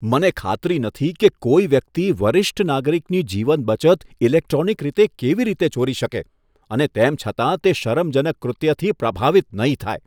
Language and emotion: Gujarati, disgusted